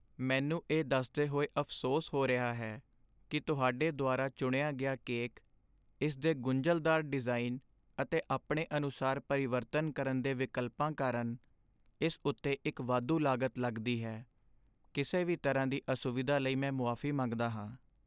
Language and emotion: Punjabi, sad